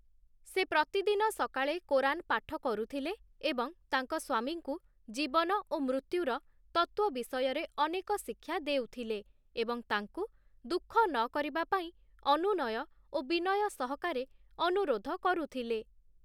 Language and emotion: Odia, neutral